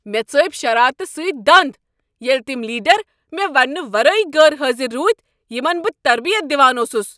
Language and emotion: Kashmiri, angry